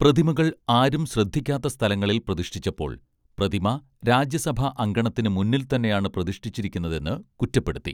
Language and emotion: Malayalam, neutral